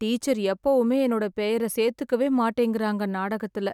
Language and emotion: Tamil, sad